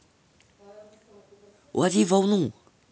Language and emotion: Russian, positive